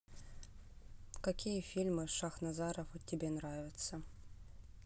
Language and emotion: Russian, neutral